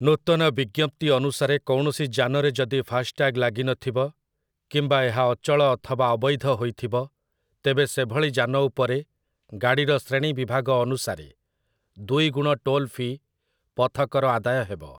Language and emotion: Odia, neutral